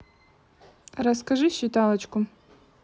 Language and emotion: Russian, neutral